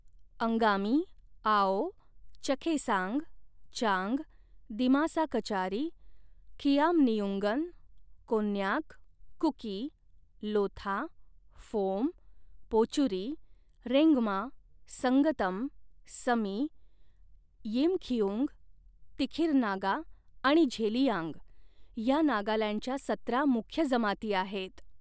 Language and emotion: Marathi, neutral